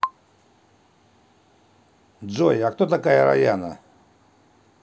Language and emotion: Russian, neutral